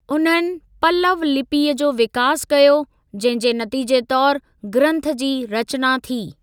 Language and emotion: Sindhi, neutral